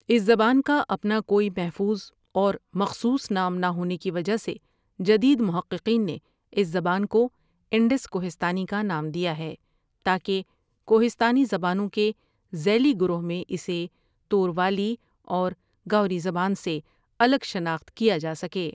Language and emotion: Urdu, neutral